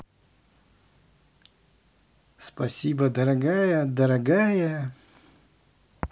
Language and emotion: Russian, positive